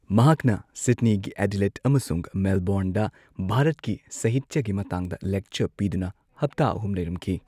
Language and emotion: Manipuri, neutral